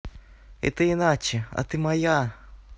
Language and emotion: Russian, neutral